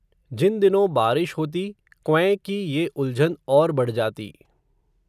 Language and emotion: Hindi, neutral